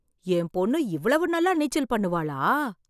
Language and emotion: Tamil, surprised